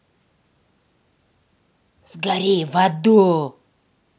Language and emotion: Russian, angry